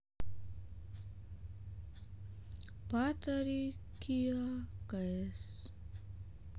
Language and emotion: Russian, sad